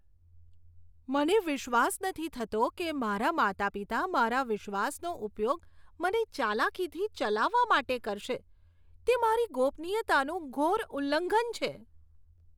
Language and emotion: Gujarati, disgusted